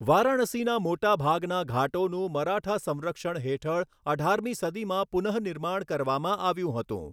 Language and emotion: Gujarati, neutral